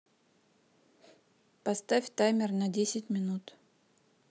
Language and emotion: Russian, neutral